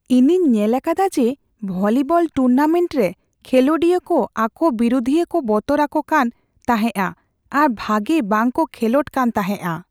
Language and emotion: Santali, fearful